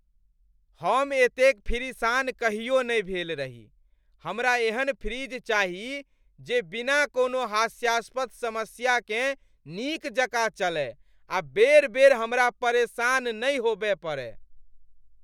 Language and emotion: Maithili, angry